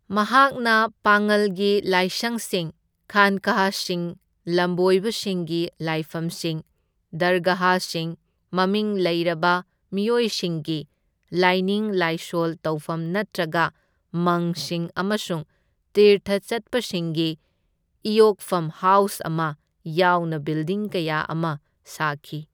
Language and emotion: Manipuri, neutral